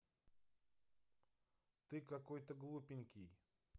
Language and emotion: Russian, neutral